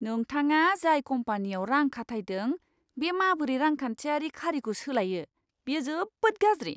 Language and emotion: Bodo, disgusted